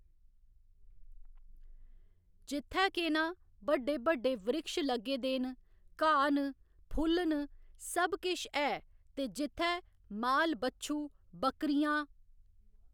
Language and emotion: Dogri, neutral